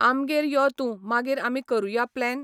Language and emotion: Goan Konkani, neutral